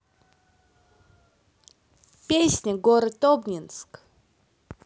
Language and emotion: Russian, positive